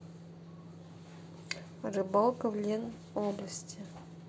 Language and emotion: Russian, neutral